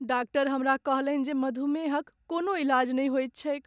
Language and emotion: Maithili, sad